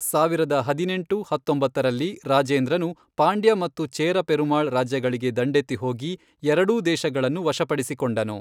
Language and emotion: Kannada, neutral